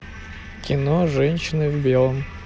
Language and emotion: Russian, neutral